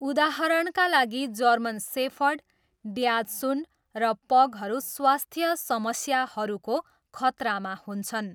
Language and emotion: Nepali, neutral